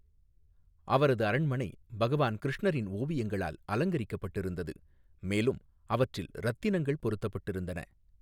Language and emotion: Tamil, neutral